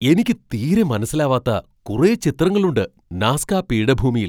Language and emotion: Malayalam, surprised